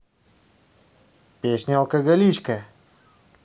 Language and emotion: Russian, positive